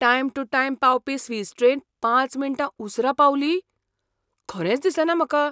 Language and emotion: Goan Konkani, surprised